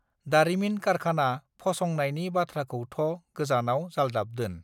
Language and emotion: Bodo, neutral